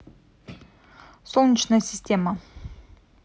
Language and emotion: Russian, neutral